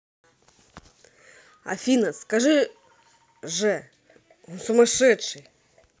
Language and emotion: Russian, neutral